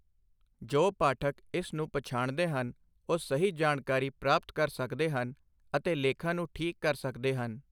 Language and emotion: Punjabi, neutral